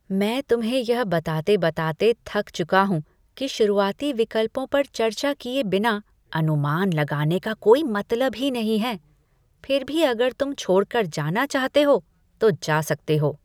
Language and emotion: Hindi, disgusted